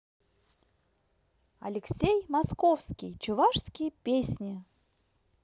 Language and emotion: Russian, positive